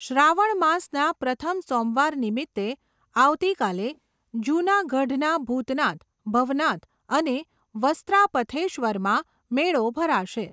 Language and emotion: Gujarati, neutral